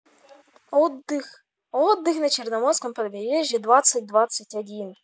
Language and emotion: Russian, positive